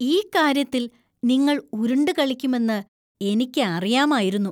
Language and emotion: Malayalam, disgusted